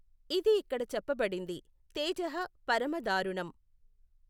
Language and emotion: Telugu, neutral